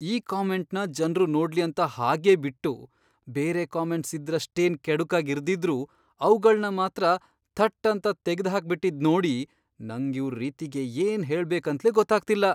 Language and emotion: Kannada, surprised